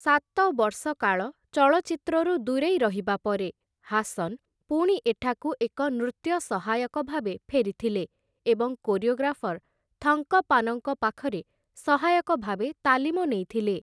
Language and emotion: Odia, neutral